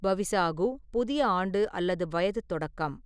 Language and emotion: Tamil, neutral